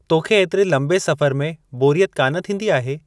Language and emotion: Sindhi, neutral